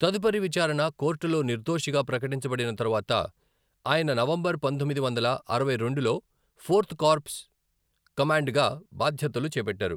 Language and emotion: Telugu, neutral